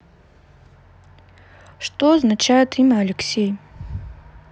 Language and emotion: Russian, neutral